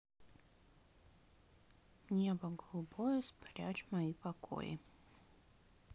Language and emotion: Russian, neutral